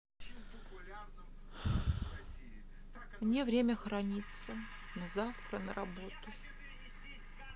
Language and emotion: Russian, sad